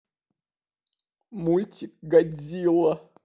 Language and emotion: Russian, sad